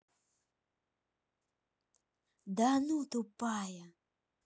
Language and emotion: Russian, neutral